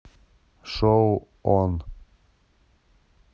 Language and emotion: Russian, neutral